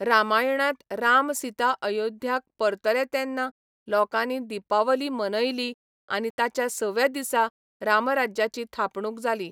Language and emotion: Goan Konkani, neutral